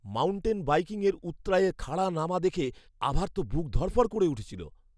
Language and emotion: Bengali, fearful